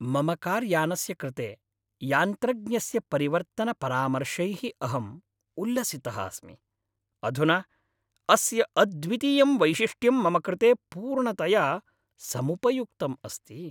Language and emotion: Sanskrit, happy